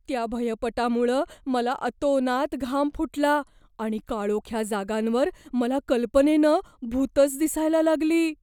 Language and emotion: Marathi, fearful